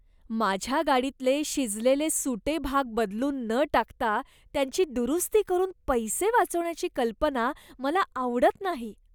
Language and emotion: Marathi, disgusted